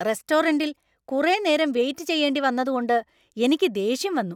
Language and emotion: Malayalam, angry